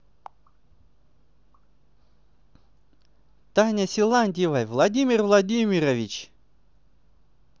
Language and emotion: Russian, positive